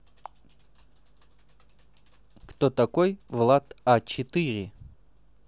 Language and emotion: Russian, neutral